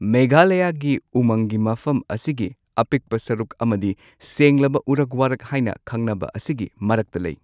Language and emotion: Manipuri, neutral